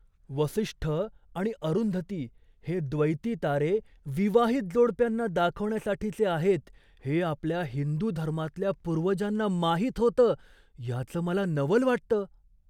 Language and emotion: Marathi, surprised